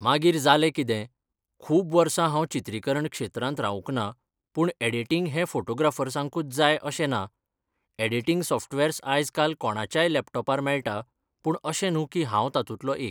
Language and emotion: Goan Konkani, neutral